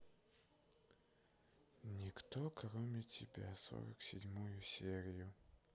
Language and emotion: Russian, sad